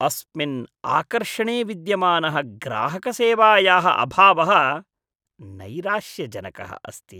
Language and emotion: Sanskrit, disgusted